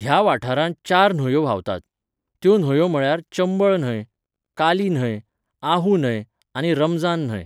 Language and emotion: Goan Konkani, neutral